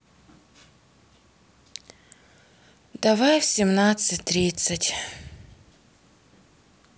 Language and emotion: Russian, sad